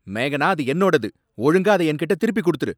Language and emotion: Tamil, angry